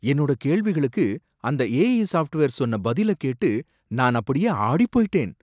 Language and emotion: Tamil, surprised